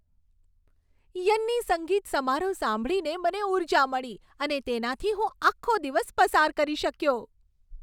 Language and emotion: Gujarati, happy